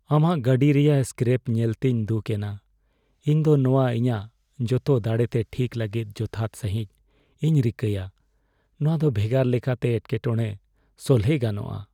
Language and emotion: Santali, sad